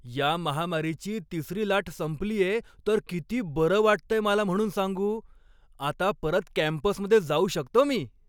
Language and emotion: Marathi, happy